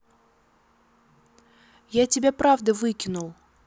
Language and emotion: Russian, neutral